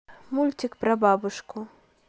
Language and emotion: Russian, neutral